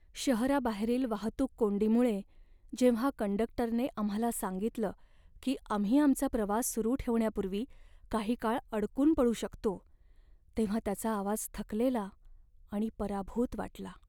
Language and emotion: Marathi, sad